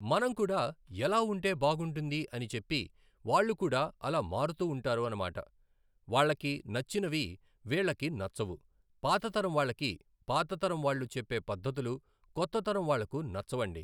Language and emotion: Telugu, neutral